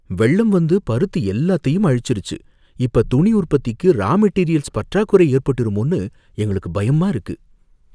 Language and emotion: Tamil, fearful